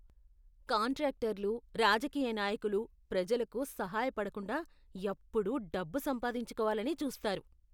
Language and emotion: Telugu, disgusted